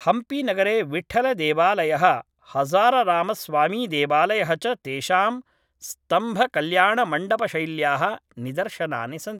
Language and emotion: Sanskrit, neutral